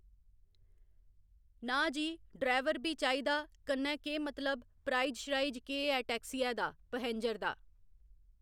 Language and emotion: Dogri, neutral